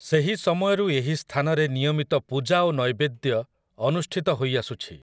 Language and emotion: Odia, neutral